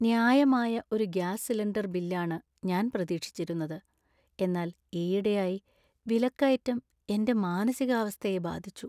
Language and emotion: Malayalam, sad